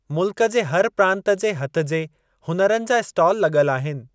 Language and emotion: Sindhi, neutral